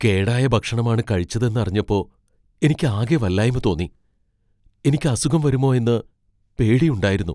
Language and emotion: Malayalam, fearful